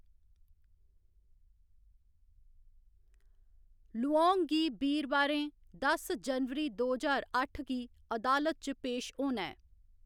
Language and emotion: Dogri, neutral